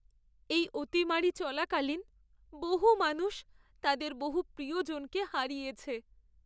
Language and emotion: Bengali, sad